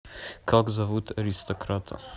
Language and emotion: Russian, neutral